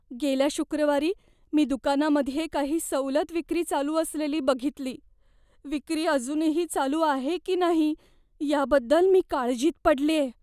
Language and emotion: Marathi, fearful